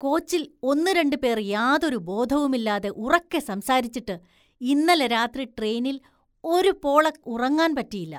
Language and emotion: Malayalam, disgusted